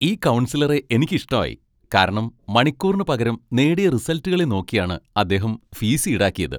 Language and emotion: Malayalam, happy